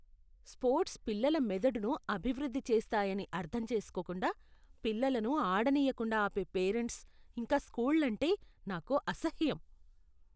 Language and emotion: Telugu, disgusted